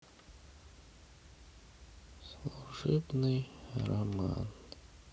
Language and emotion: Russian, sad